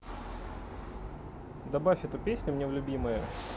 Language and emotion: Russian, neutral